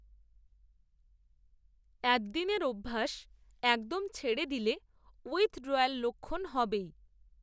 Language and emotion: Bengali, neutral